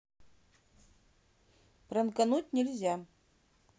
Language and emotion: Russian, neutral